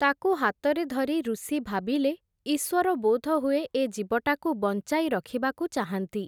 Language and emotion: Odia, neutral